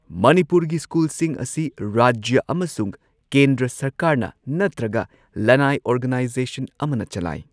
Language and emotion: Manipuri, neutral